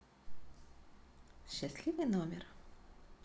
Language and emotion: Russian, neutral